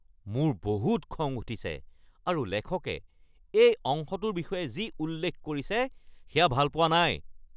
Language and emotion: Assamese, angry